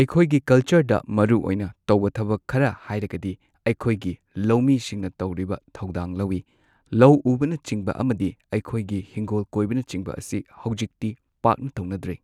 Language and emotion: Manipuri, neutral